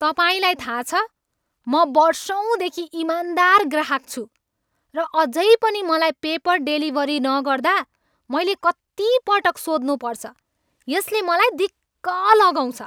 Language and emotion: Nepali, angry